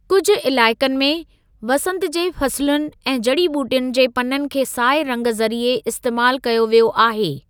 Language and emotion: Sindhi, neutral